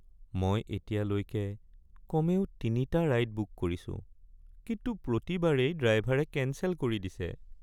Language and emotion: Assamese, sad